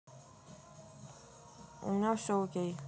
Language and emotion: Russian, neutral